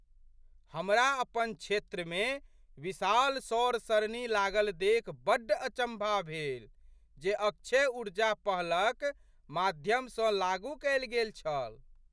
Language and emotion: Maithili, surprised